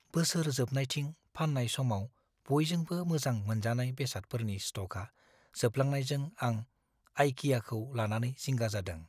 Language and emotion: Bodo, fearful